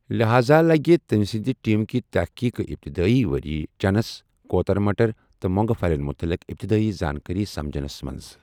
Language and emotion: Kashmiri, neutral